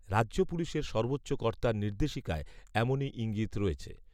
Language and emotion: Bengali, neutral